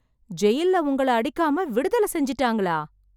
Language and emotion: Tamil, surprised